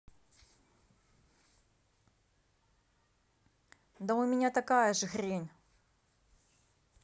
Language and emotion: Russian, angry